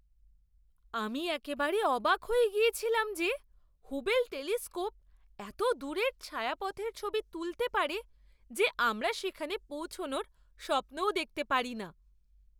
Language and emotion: Bengali, surprised